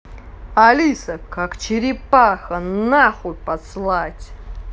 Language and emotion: Russian, angry